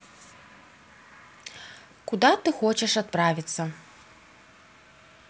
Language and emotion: Russian, neutral